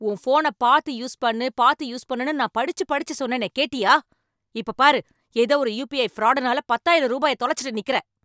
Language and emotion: Tamil, angry